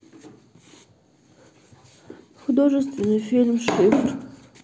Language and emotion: Russian, sad